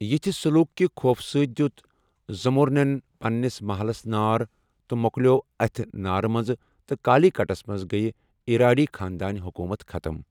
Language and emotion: Kashmiri, neutral